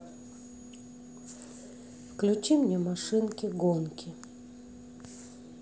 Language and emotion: Russian, neutral